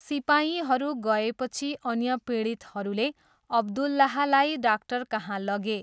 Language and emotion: Nepali, neutral